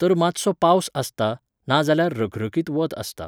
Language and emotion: Goan Konkani, neutral